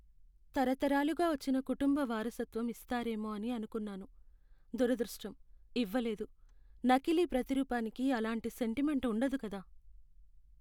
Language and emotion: Telugu, sad